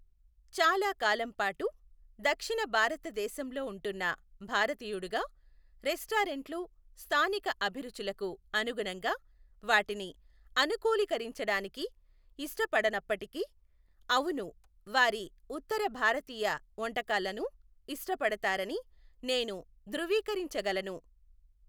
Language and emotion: Telugu, neutral